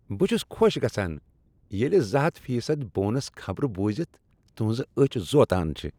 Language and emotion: Kashmiri, happy